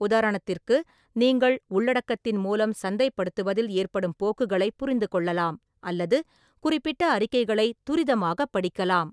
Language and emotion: Tamil, neutral